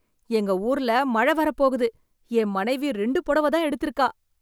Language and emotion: Tamil, surprised